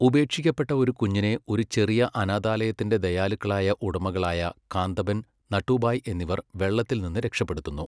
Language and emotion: Malayalam, neutral